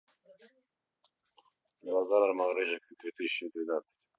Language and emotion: Russian, neutral